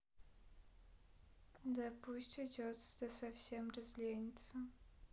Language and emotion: Russian, sad